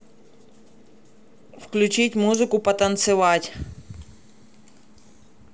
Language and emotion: Russian, neutral